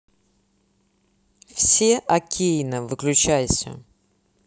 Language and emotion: Russian, neutral